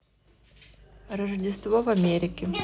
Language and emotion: Russian, neutral